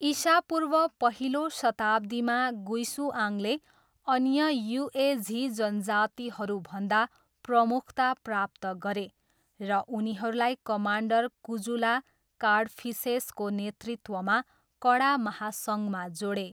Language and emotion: Nepali, neutral